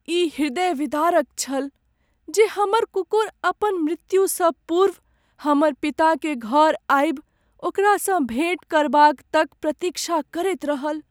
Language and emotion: Maithili, sad